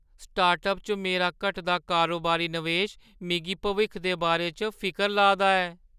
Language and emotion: Dogri, fearful